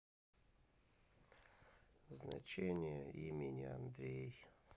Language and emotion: Russian, sad